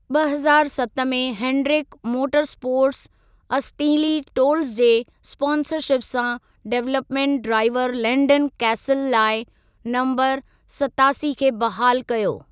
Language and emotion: Sindhi, neutral